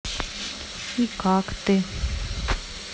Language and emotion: Russian, neutral